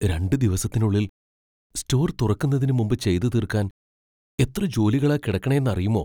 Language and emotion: Malayalam, fearful